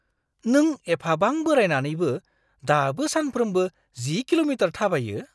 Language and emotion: Bodo, surprised